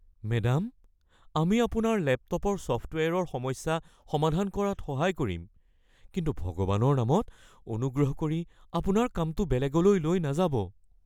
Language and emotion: Assamese, fearful